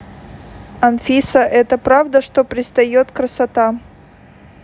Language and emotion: Russian, neutral